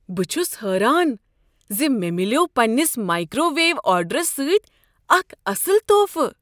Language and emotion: Kashmiri, surprised